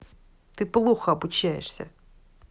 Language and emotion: Russian, angry